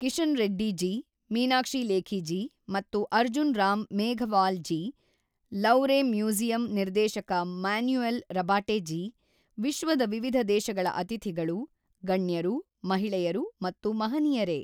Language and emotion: Kannada, neutral